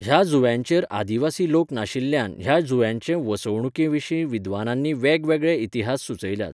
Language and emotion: Goan Konkani, neutral